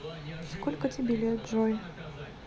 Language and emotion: Russian, neutral